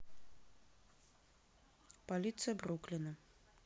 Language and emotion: Russian, neutral